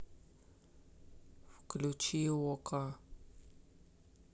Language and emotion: Russian, neutral